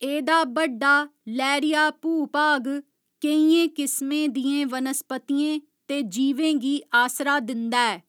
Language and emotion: Dogri, neutral